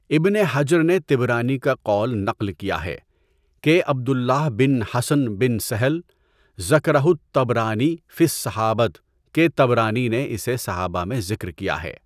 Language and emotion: Urdu, neutral